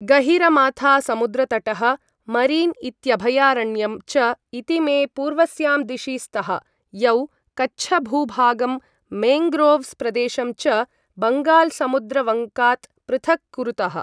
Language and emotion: Sanskrit, neutral